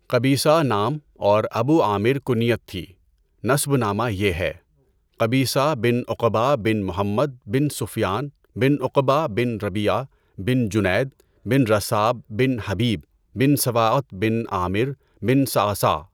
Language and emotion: Urdu, neutral